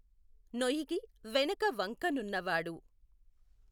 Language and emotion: Telugu, neutral